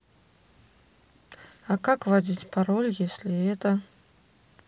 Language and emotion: Russian, neutral